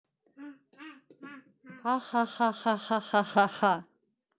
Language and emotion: Russian, neutral